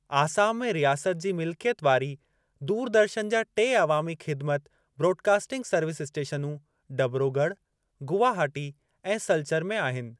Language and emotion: Sindhi, neutral